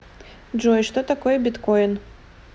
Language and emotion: Russian, neutral